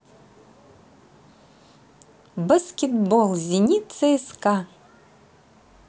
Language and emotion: Russian, positive